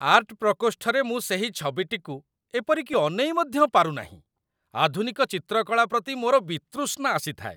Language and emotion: Odia, disgusted